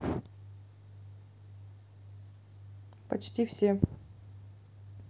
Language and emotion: Russian, neutral